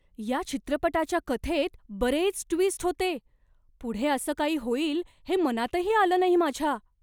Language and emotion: Marathi, surprised